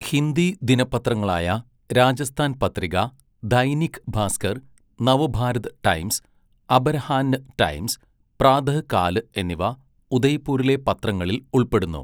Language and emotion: Malayalam, neutral